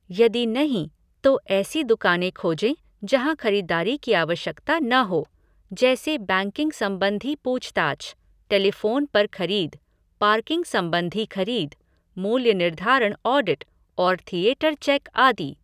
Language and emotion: Hindi, neutral